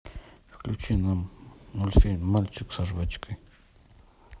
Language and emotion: Russian, neutral